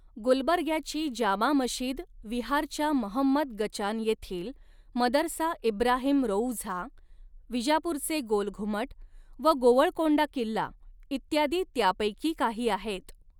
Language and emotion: Marathi, neutral